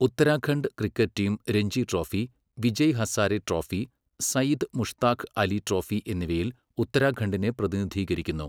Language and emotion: Malayalam, neutral